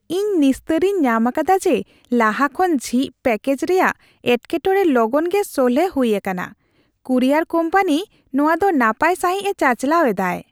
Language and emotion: Santali, happy